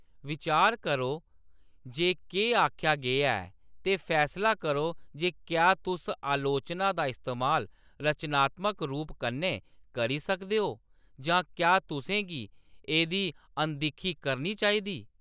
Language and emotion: Dogri, neutral